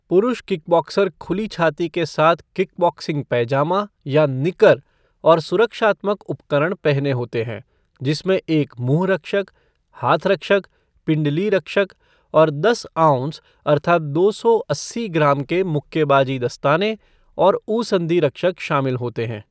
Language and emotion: Hindi, neutral